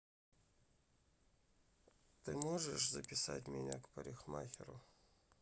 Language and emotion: Russian, sad